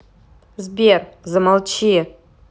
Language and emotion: Russian, angry